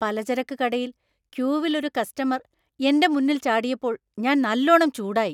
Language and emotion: Malayalam, angry